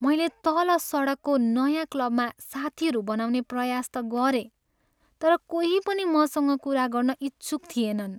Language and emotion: Nepali, sad